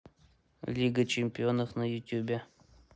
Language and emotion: Russian, neutral